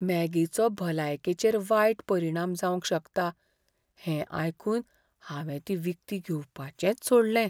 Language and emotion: Goan Konkani, fearful